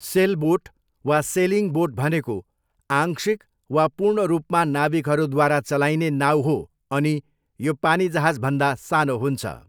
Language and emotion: Nepali, neutral